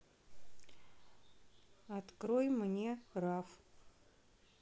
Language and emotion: Russian, neutral